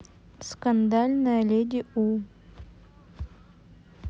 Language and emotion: Russian, neutral